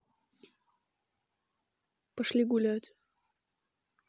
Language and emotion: Russian, neutral